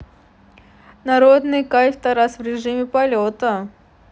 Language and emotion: Russian, neutral